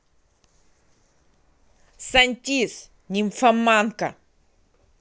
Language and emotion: Russian, angry